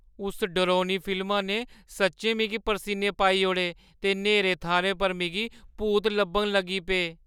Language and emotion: Dogri, fearful